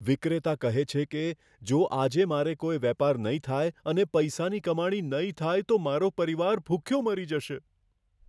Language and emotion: Gujarati, fearful